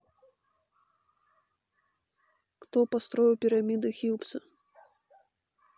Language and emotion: Russian, neutral